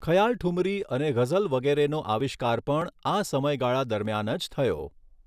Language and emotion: Gujarati, neutral